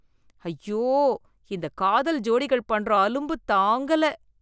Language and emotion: Tamil, disgusted